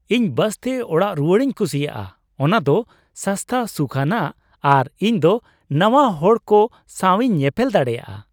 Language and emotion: Santali, happy